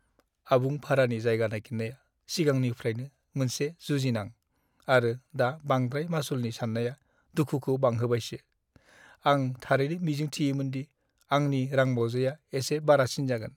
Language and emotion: Bodo, sad